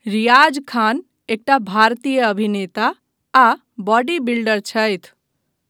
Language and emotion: Maithili, neutral